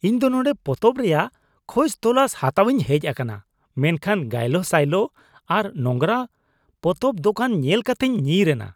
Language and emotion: Santali, disgusted